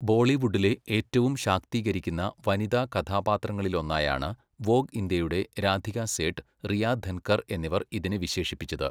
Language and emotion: Malayalam, neutral